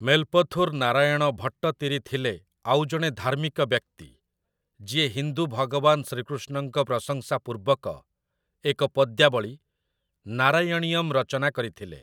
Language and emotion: Odia, neutral